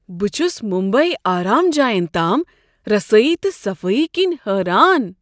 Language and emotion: Kashmiri, surprised